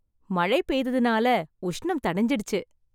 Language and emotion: Tamil, happy